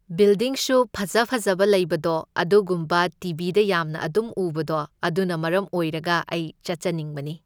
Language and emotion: Manipuri, neutral